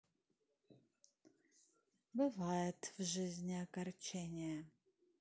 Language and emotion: Russian, sad